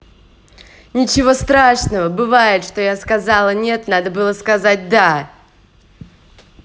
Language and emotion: Russian, positive